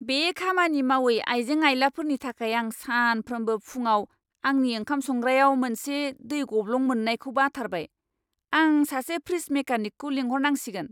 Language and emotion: Bodo, angry